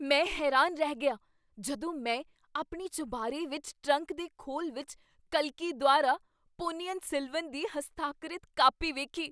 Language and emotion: Punjabi, surprised